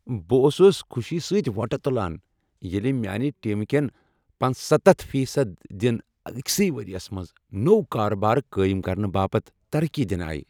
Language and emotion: Kashmiri, happy